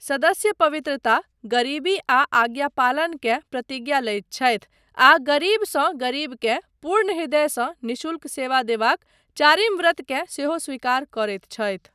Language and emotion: Maithili, neutral